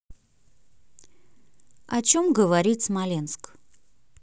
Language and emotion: Russian, neutral